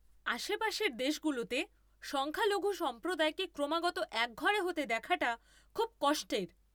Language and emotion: Bengali, angry